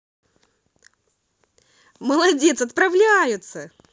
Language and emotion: Russian, positive